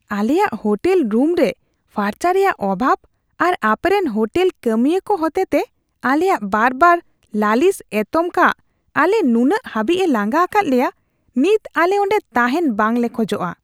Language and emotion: Santali, disgusted